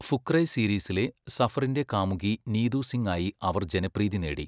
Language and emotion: Malayalam, neutral